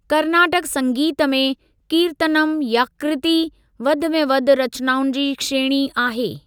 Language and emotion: Sindhi, neutral